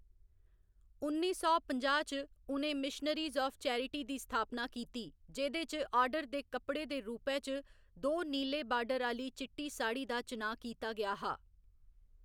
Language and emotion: Dogri, neutral